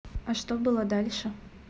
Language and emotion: Russian, neutral